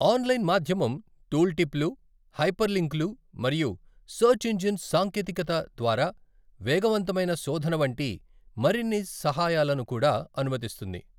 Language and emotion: Telugu, neutral